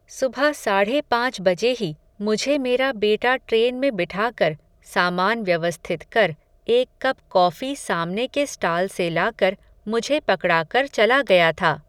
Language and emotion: Hindi, neutral